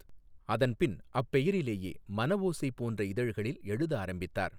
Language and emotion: Tamil, neutral